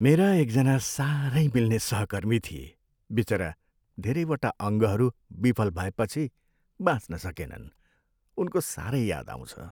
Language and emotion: Nepali, sad